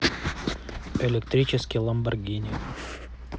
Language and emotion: Russian, neutral